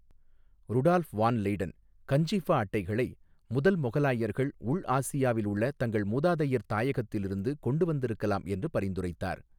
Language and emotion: Tamil, neutral